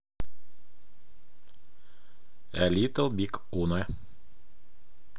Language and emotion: Russian, neutral